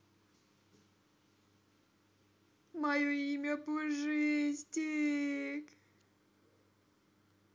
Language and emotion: Russian, sad